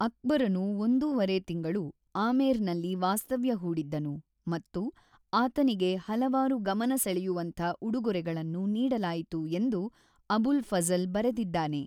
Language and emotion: Kannada, neutral